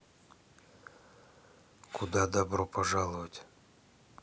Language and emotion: Russian, neutral